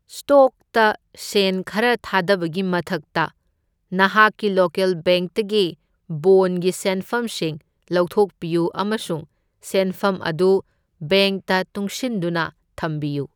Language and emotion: Manipuri, neutral